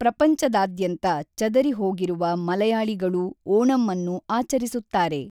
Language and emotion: Kannada, neutral